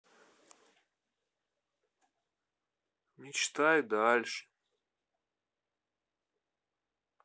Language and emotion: Russian, neutral